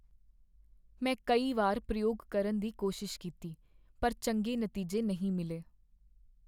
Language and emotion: Punjabi, sad